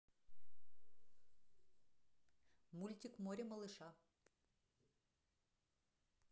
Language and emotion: Russian, neutral